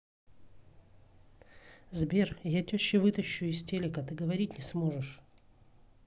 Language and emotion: Russian, angry